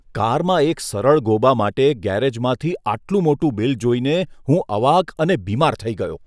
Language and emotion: Gujarati, disgusted